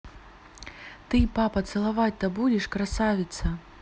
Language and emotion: Russian, neutral